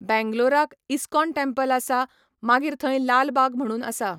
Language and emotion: Goan Konkani, neutral